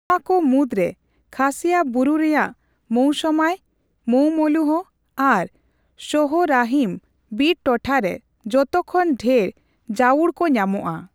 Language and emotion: Santali, neutral